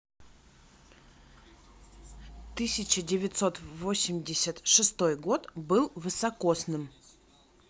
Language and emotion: Russian, neutral